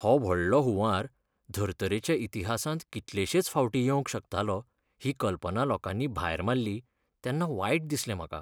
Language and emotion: Goan Konkani, sad